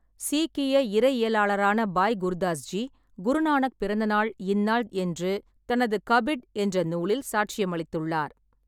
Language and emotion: Tamil, neutral